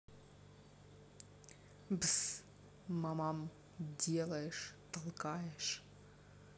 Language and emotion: Russian, neutral